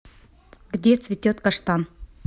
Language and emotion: Russian, neutral